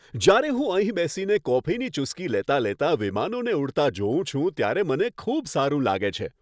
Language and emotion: Gujarati, happy